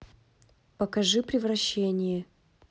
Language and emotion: Russian, neutral